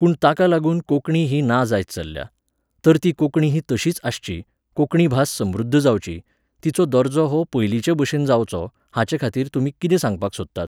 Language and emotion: Goan Konkani, neutral